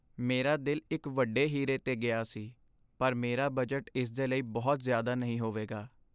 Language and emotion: Punjabi, sad